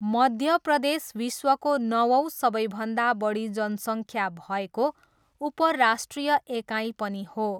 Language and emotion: Nepali, neutral